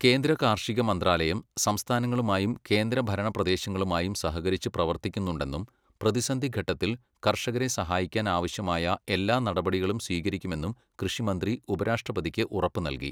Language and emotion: Malayalam, neutral